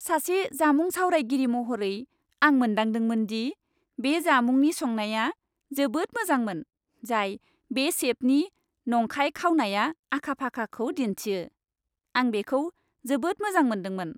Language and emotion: Bodo, happy